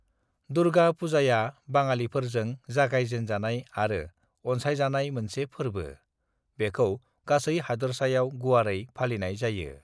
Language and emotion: Bodo, neutral